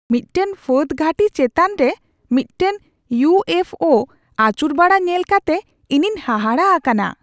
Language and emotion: Santali, surprised